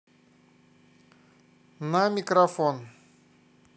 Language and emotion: Russian, neutral